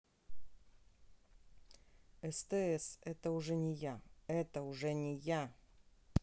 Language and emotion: Russian, angry